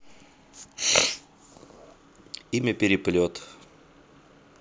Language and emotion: Russian, neutral